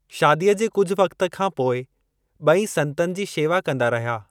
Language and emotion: Sindhi, neutral